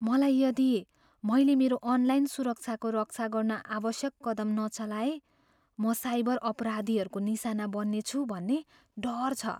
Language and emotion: Nepali, fearful